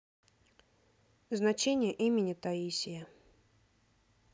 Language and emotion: Russian, neutral